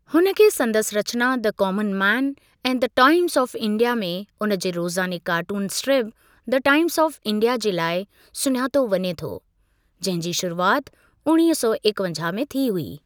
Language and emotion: Sindhi, neutral